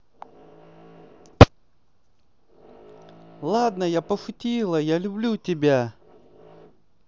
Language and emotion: Russian, positive